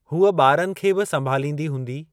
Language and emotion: Sindhi, neutral